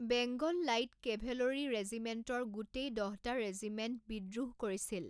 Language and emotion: Assamese, neutral